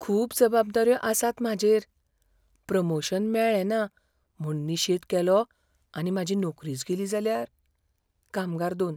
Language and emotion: Goan Konkani, fearful